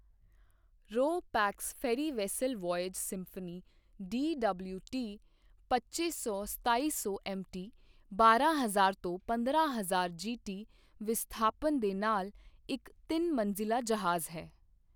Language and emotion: Punjabi, neutral